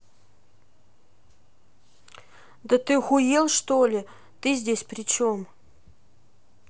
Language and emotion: Russian, angry